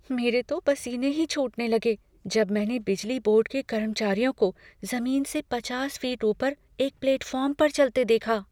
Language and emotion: Hindi, fearful